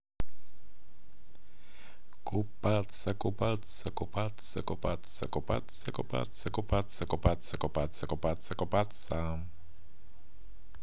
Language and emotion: Russian, positive